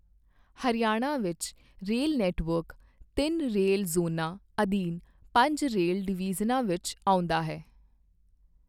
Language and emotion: Punjabi, neutral